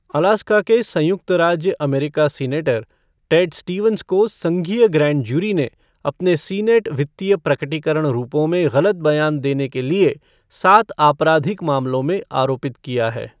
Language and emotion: Hindi, neutral